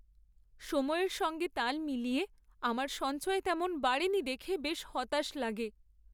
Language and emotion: Bengali, sad